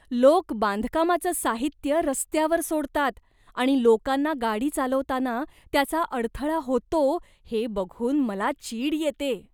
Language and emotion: Marathi, disgusted